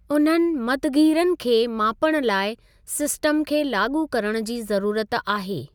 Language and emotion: Sindhi, neutral